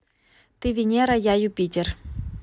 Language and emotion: Russian, neutral